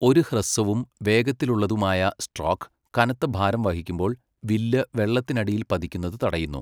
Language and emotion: Malayalam, neutral